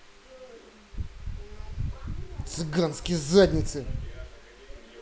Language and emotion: Russian, angry